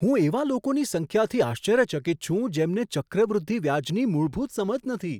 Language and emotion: Gujarati, surprised